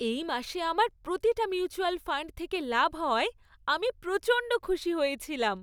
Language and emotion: Bengali, happy